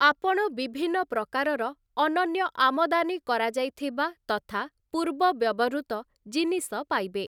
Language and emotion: Odia, neutral